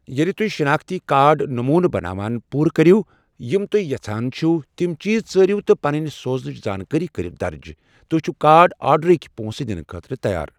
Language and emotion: Kashmiri, neutral